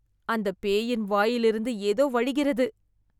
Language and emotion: Tamil, disgusted